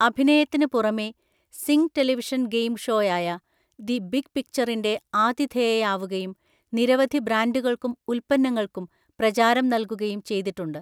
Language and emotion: Malayalam, neutral